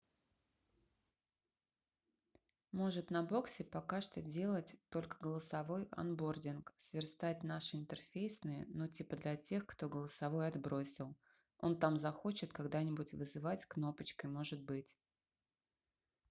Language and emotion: Russian, neutral